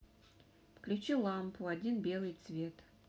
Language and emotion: Russian, neutral